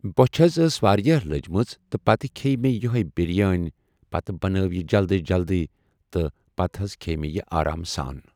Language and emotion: Kashmiri, neutral